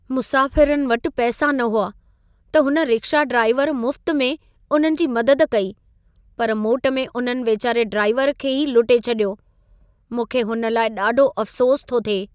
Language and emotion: Sindhi, sad